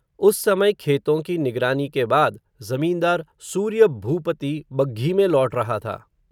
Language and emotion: Hindi, neutral